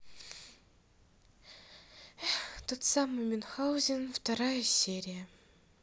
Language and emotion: Russian, sad